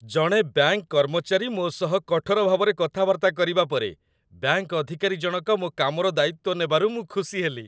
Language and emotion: Odia, happy